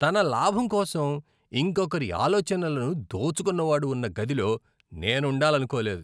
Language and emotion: Telugu, disgusted